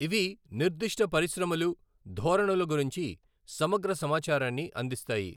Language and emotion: Telugu, neutral